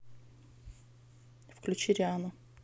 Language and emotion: Russian, neutral